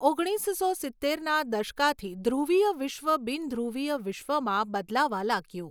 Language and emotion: Gujarati, neutral